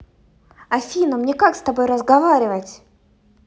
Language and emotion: Russian, angry